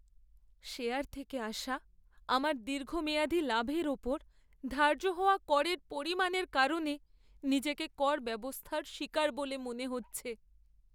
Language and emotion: Bengali, sad